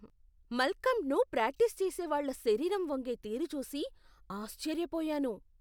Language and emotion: Telugu, surprised